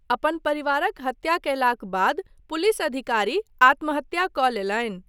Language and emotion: Maithili, neutral